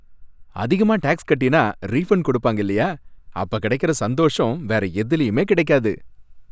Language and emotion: Tamil, happy